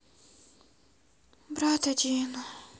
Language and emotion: Russian, sad